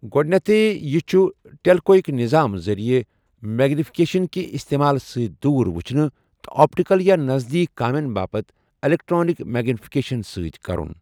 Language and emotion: Kashmiri, neutral